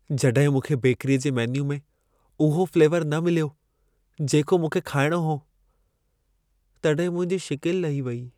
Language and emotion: Sindhi, sad